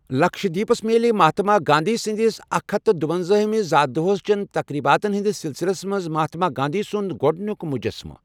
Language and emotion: Kashmiri, neutral